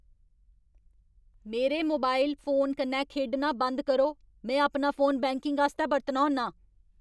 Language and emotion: Dogri, angry